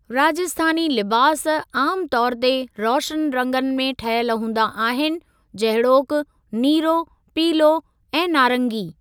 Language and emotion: Sindhi, neutral